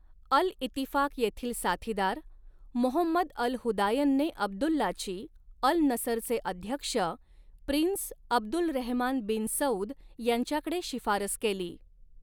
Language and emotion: Marathi, neutral